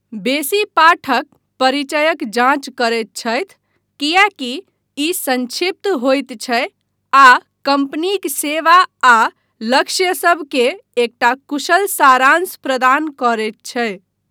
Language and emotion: Maithili, neutral